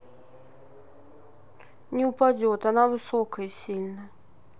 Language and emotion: Russian, neutral